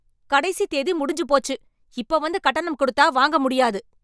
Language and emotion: Tamil, angry